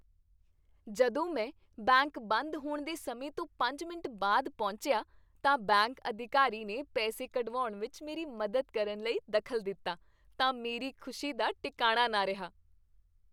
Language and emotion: Punjabi, happy